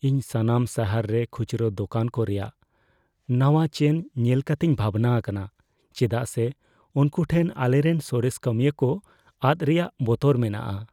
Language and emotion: Santali, fearful